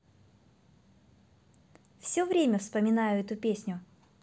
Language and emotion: Russian, positive